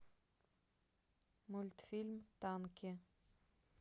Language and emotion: Russian, neutral